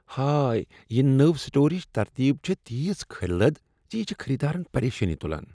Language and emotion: Kashmiri, disgusted